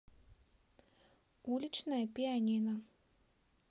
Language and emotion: Russian, neutral